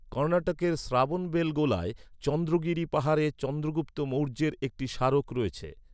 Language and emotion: Bengali, neutral